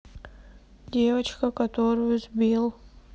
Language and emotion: Russian, sad